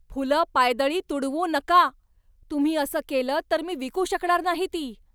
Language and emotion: Marathi, angry